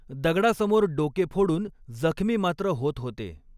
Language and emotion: Marathi, neutral